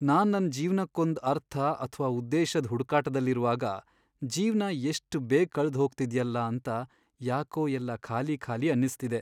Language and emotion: Kannada, sad